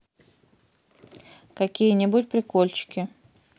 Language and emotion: Russian, neutral